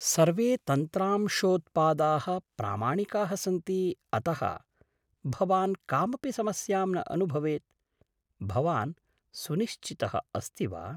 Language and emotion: Sanskrit, surprised